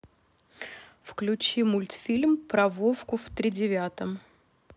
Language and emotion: Russian, neutral